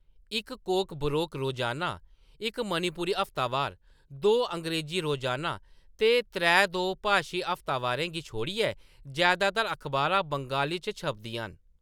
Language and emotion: Dogri, neutral